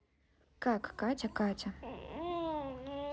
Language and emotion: Russian, neutral